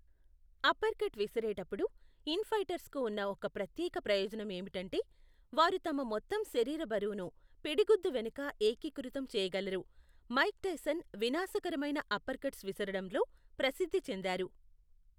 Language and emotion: Telugu, neutral